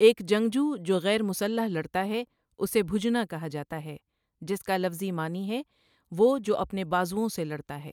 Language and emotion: Urdu, neutral